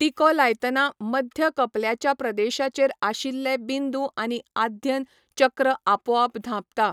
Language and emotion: Goan Konkani, neutral